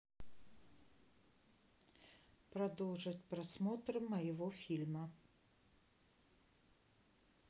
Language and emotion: Russian, neutral